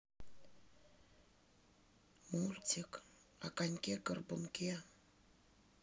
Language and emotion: Russian, neutral